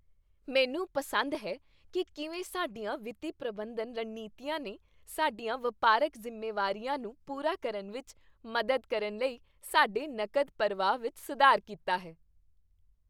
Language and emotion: Punjabi, happy